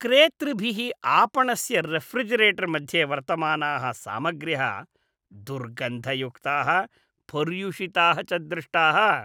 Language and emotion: Sanskrit, disgusted